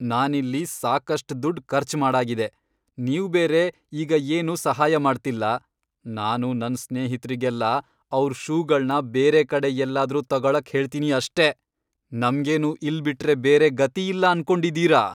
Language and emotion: Kannada, angry